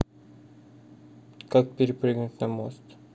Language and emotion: Russian, neutral